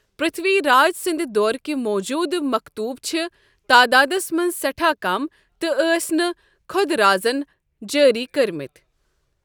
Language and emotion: Kashmiri, neutral